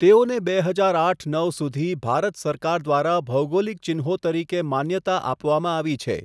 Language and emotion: Gujarati, neutral